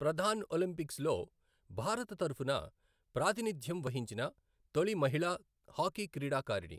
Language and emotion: Telugu, neutral